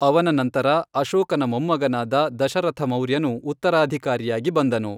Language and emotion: Kannada, neutral